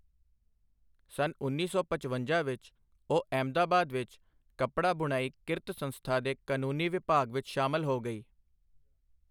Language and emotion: Punjabi, neutral